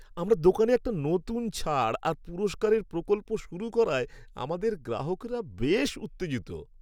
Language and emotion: Bengali, happy